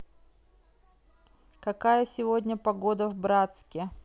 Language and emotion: Russian, neutral